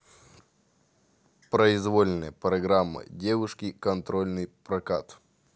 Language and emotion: Russian, neutral